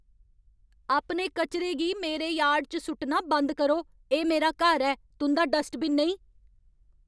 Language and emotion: Dogri, angry